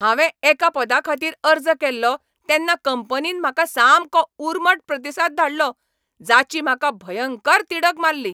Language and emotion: Goan Konkani, angry